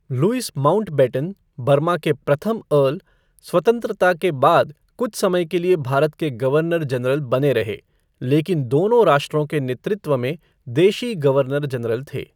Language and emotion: Hindi, neutral